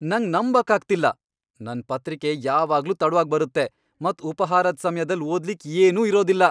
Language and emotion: Kannada, angry